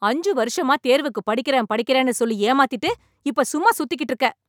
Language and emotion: Tamil, angry